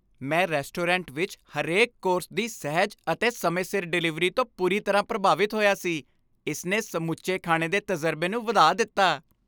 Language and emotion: Punjabi, happy